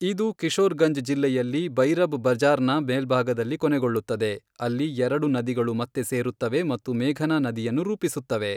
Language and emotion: Kannada, neutral